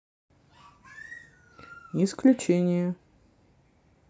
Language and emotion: Russian, neutral